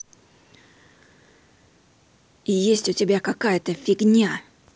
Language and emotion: Russian, angry